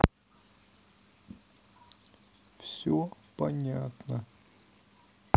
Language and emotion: Russian, sad